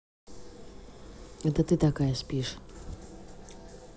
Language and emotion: Russian, neutral